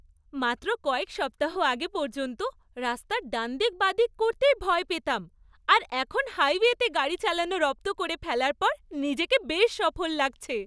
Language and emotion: Bengali, happy